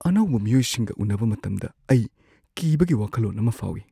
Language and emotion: Manipuri, fearful